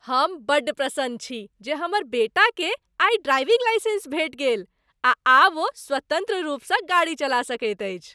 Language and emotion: Maithili, happy